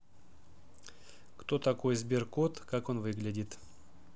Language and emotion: Russian, neutral